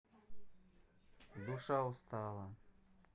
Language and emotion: Russian, neutral